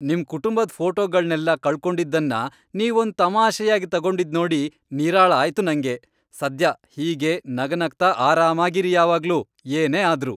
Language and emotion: Kannada, happy